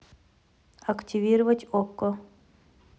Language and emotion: Russian, neutral